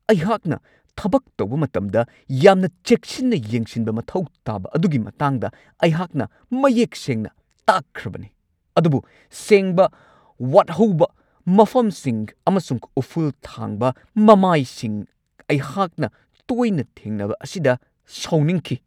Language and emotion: Manipuri, angry